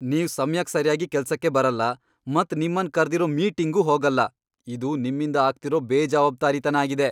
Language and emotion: Kannada, angry